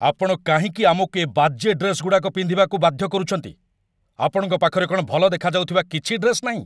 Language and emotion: Odia, angry